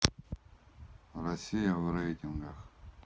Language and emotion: Russian, neutral